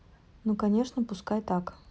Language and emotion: Russian, neutral